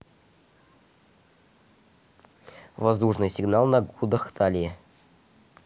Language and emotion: Russian, neutral